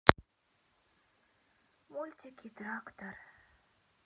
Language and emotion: Russian, sad